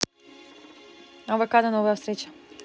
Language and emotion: Russian, neutral